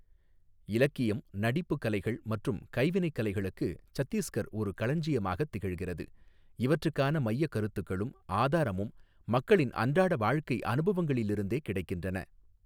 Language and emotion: Tamil, neutral